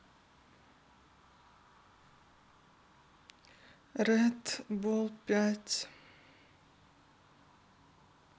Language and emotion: Russian, sad